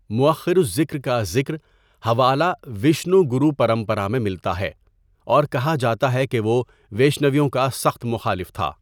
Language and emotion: Urdu, neutral